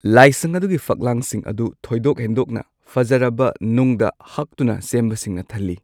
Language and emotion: Manipuri, neutral